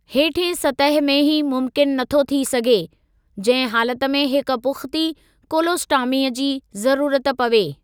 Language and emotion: Sindhi, neutral